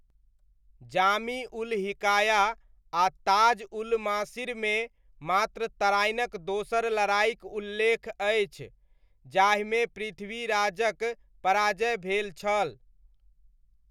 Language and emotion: Maithili, neutral